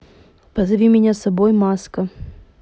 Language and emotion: Russian, neutral